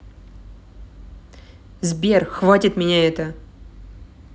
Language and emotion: Russian, angry